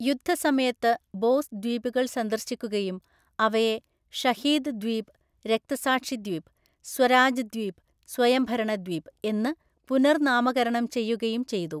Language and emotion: Malayalam, neutral